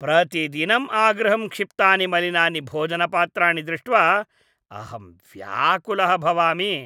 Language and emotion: Sanskrit, disgusted